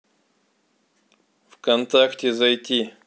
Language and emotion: Russian, neutral